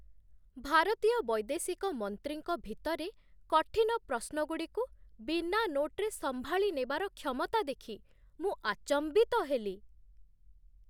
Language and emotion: Odia, surprised